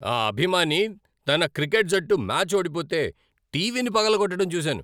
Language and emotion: Telugu, angry